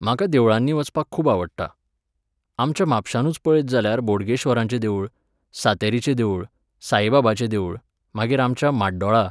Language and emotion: Goan Konkani, neutral